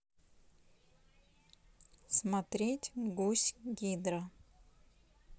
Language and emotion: Russian, neutral